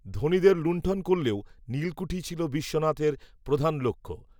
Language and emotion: Bengali, neutral